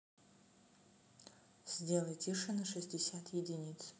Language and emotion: Russian, neutral